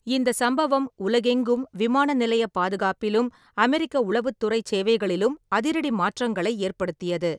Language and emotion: Tamil, neutral